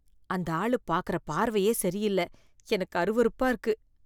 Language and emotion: Tamil, disgusted